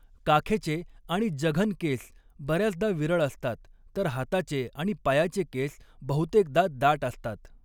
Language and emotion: Marathi, neutral